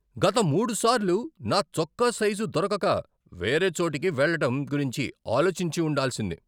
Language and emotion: Telugu, angry